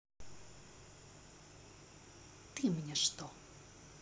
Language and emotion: Russian, angry